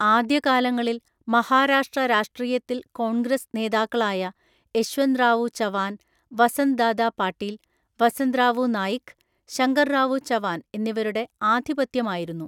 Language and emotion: Malayalam, neutral